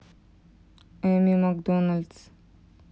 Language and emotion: Russian, neutral